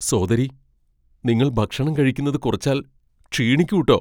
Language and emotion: Malayalam, fearful